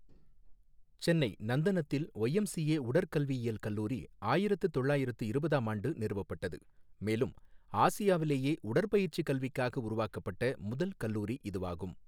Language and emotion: Tamil, neutral